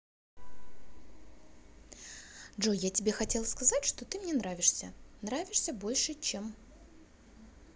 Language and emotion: Russian, positive